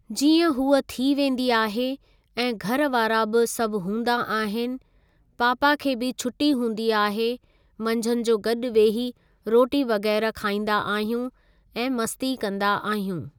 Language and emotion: Sindhi, neutral